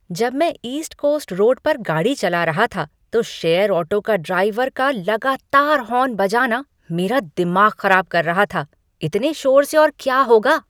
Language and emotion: Hindi, angry